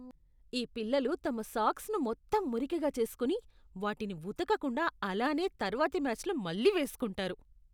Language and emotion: Telugu, disgusted